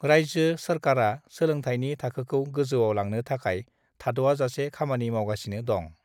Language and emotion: Bodo, neutral